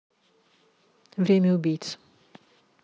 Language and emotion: Russian, neutral